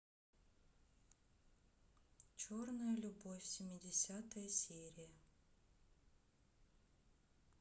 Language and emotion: Russian, neutral